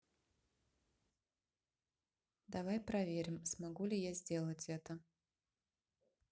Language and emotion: Russian, neutral